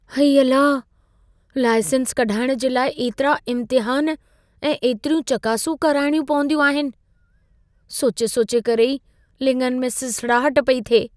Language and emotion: Sindhi, fearful